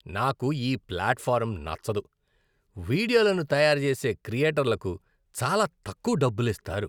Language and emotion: Telugu, disgusted